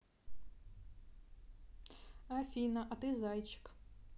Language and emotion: Russian, neutral